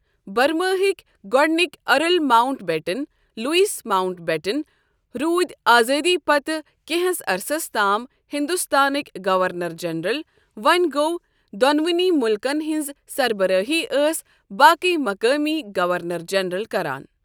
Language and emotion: Kashmiri, neutral